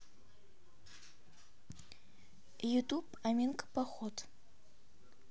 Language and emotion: Russian, neutral